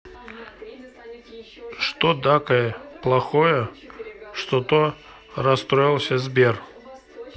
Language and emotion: Russian, neutral